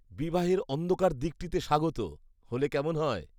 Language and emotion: Bengali, disgusted